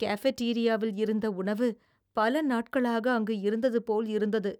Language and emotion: Tamil, disgusted